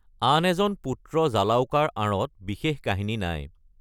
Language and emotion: Assamese, neutral